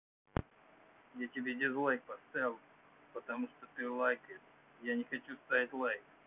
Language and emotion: Russian, angry